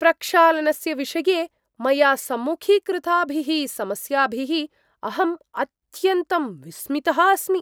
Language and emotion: Sanskrit, surprised